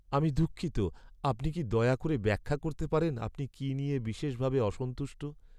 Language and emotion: Bengali, sad